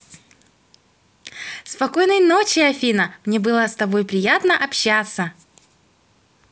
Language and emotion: Russian, positive